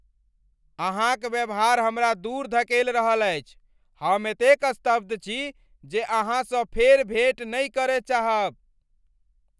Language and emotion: Maithili, angry